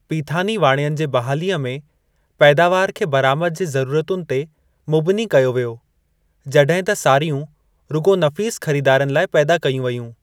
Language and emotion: Sindhi, neutral